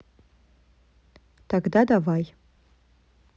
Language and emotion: Russian, neutral